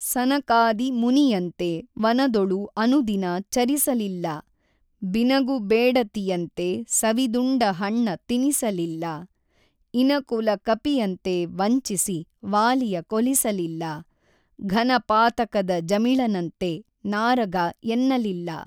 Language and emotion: Kannada, neutral